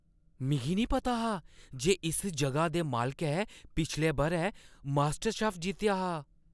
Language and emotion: Dogri, surprised